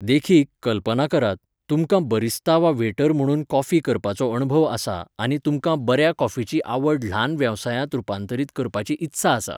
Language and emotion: Goan Konkani, neutral